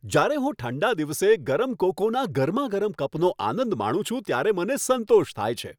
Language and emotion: Gujarati, happy